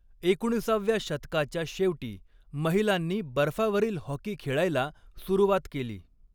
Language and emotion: Marathi, neutral